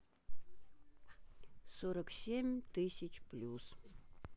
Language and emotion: Russian, neutral